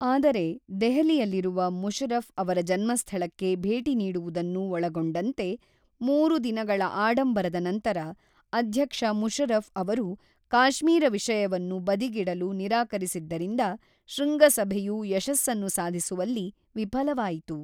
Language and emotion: Kannada, neutral